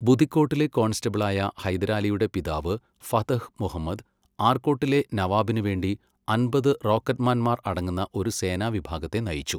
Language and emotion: Malayalam, neutral